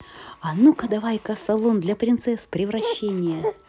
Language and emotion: Russian, positive